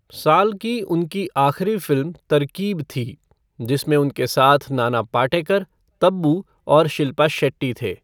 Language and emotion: Hindi, neutral